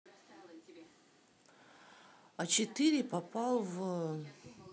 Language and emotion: Russian, neutral